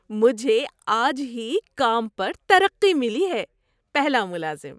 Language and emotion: Urdu, happy